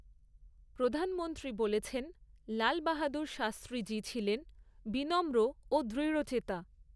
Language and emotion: Bengali, neutral